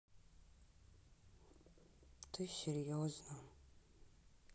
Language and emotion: Russian, sad